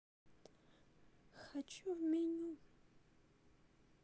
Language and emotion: Russian, sad